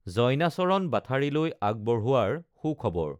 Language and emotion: Assamese, neutral